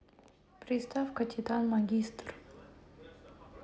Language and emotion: Russian, neutral